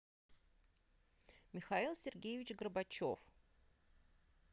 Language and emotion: Russian, neutral